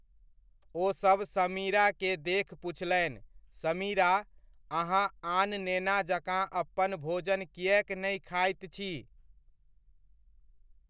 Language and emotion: Maithili, neutral